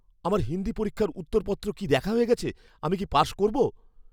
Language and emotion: Bengali, fearful